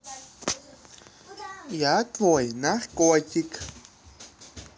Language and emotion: Russian, positive